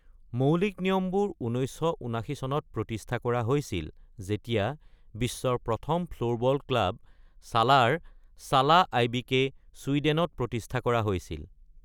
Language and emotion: Assamese, neutral